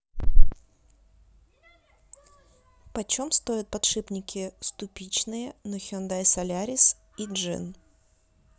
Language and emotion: Russian, neutral